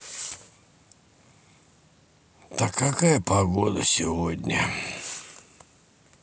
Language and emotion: Russian, sad